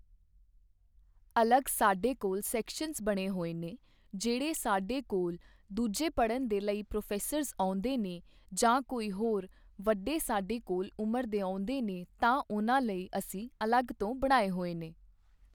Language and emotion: Punjabi, neutral